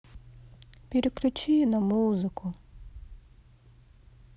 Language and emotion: Russian, sad